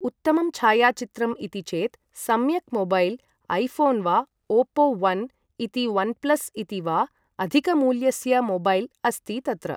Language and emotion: Sanskrit, neutral